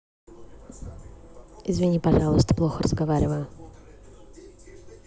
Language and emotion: Russian, neutral